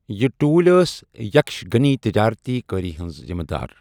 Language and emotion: Kashmiri, neutral